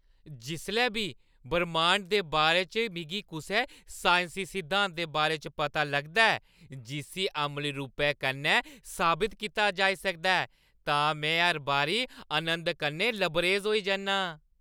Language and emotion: Dogri, happy